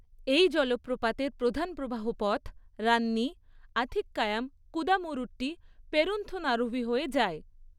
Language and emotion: Bengali, neutral